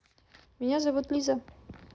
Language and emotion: Russian, neutral